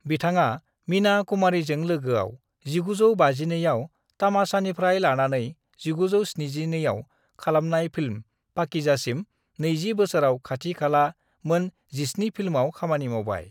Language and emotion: Bodo, neutral